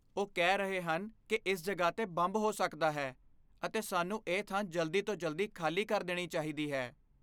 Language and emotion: Punjabi, fearful